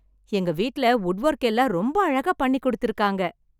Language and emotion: Tamil, happy